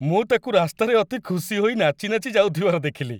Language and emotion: Odia, happy